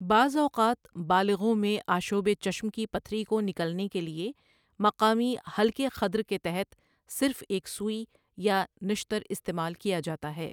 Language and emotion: Urdu, neutral